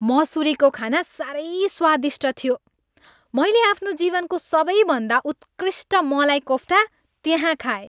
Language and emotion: Nepali, happy